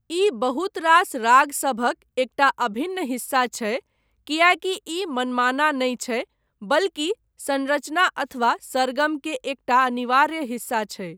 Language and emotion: Maithili, neutral